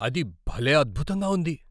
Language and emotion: Telugu, surprised